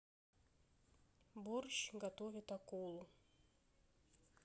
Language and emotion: Russian, neutral